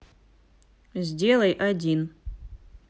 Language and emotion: Russian, neutral